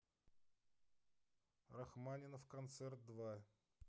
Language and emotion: Russian, neutral